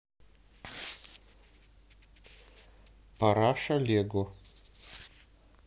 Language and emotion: Russian, neutral